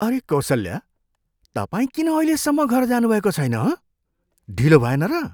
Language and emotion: Nepali, surprised